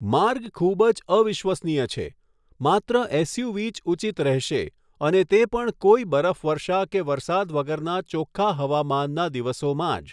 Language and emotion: Gujarati, neutral